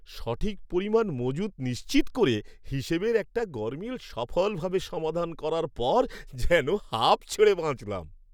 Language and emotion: Bengali, happy